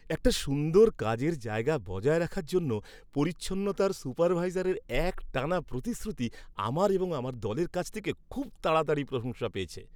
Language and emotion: Bengali, happy